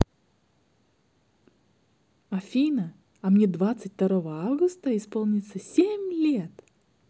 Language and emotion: Russian, positive